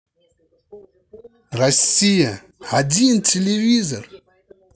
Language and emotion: Russian, positive